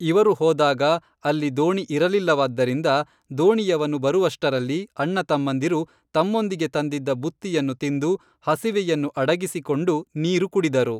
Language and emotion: Kannada, neutral